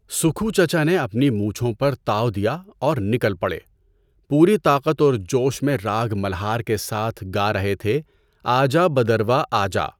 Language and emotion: Urdu, neutral